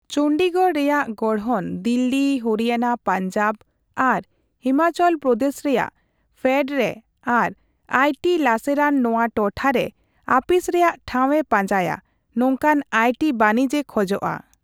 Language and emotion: Santali, neutral